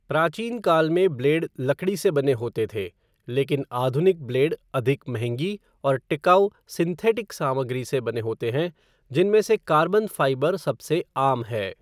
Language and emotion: Hindi, neutral